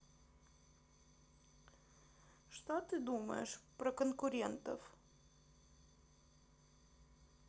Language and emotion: Russian, neutral